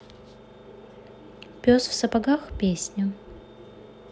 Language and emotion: Russian, neutral